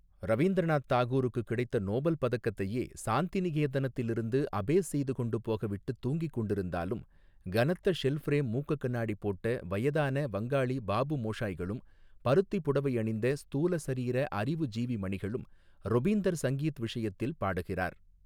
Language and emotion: Tamil, neutral